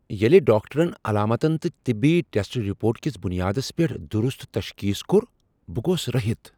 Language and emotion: Kashmiri, surprised